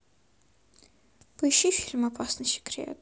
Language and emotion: Russian, neutral